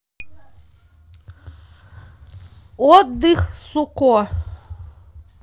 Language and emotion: Russian, neutral